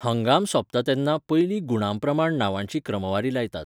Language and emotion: Goan Konkani, neutral